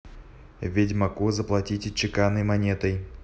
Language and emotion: Russian, neutral